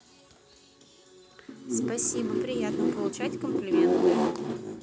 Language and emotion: Russian, neutral